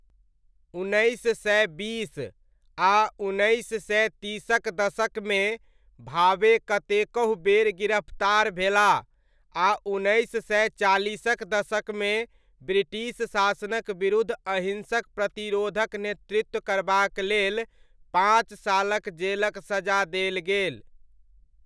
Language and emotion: Maithili, neutral